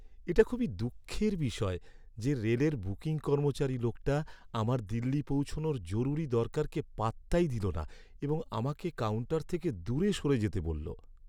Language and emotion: Bengali, sad